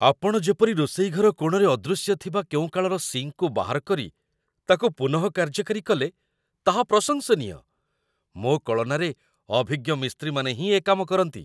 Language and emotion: Odia, surprised